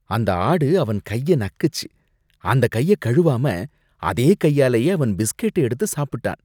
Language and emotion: Tamil, disgusted